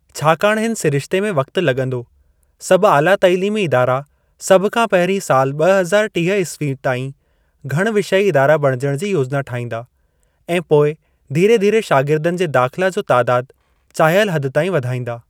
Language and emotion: Sindhi, neutral